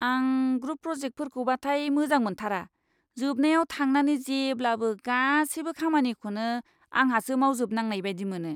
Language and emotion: Bodo, disgusted